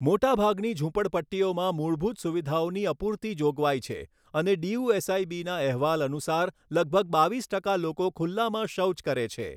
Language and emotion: Gujarati, neutral